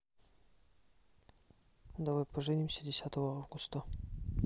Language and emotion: Russian, neutral